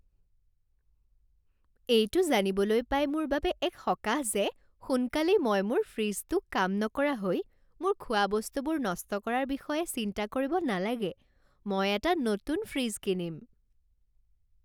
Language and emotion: Assamese, happy